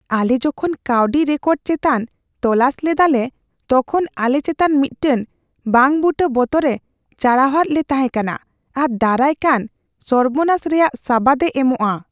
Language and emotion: Santali, fearful